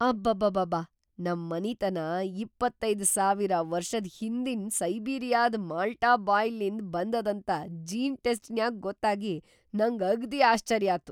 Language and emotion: Kannada, surprised